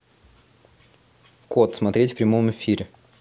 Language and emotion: Russian, neutral